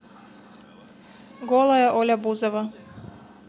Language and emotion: Russian, neutral